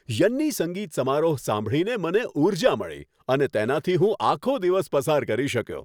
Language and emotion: Gujarati, happy